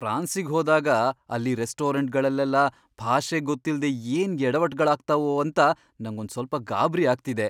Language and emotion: Kannada, fearful